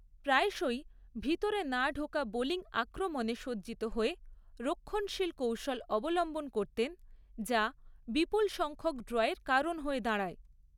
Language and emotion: Bengali, neutral